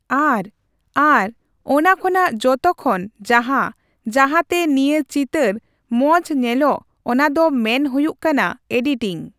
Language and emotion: Santali, neutral